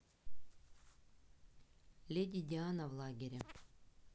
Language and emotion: Russian, neutral